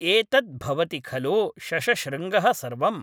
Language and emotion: Sanskrit, neutral